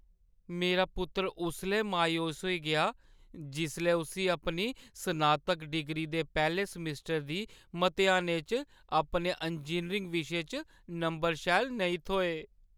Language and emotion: Dogri, sad